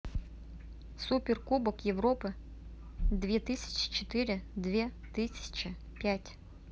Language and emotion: Russian, neutral